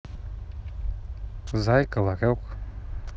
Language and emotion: Russian, neutral